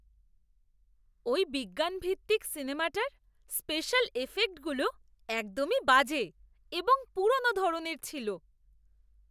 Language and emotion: Bengali, disgusted